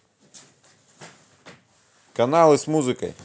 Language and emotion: Russian, positive